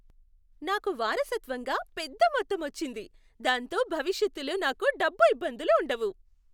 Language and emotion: Telugu, happy